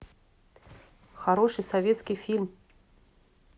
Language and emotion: Russian, neutral